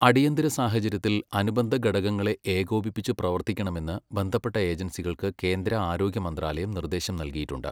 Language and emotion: Malayalam, neutral